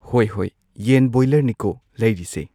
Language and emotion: Manipuri, neutral